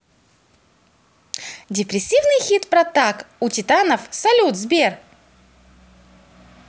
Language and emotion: Russian, positive